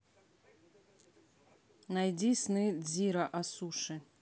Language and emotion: Russian, neutral